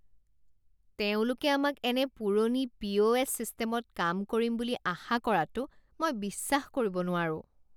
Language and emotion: Assamese, disgusted